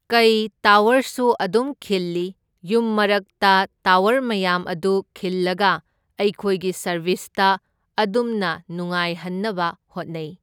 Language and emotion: Manipuri, neutral